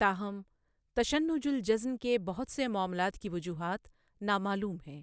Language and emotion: Urdu, neutral